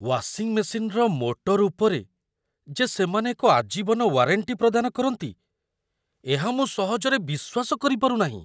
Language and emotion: Odia, surprised